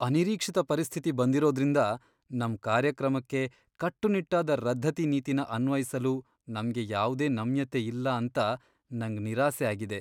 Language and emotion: Kannada, sad